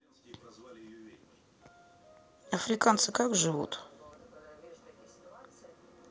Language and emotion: Russian, neutral